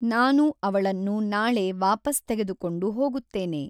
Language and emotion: Kannada, neutral